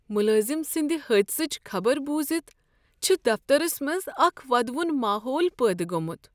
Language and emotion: Kashmiri, sad